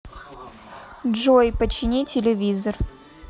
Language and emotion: Russian, neutral